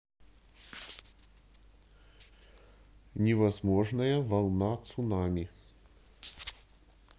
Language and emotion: Russian, neutral